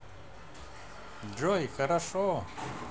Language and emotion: Russian, positive